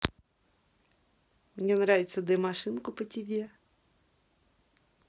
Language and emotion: Russian, positive